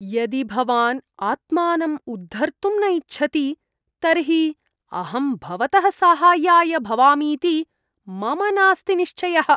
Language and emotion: Sanskrit, disgusted